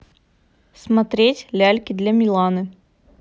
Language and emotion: Russian, neutral